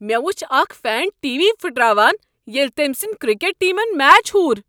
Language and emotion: Kashmiri, angry